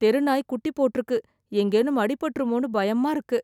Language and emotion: Tamil, fearful